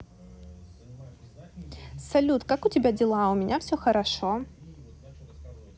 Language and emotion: Russian, positive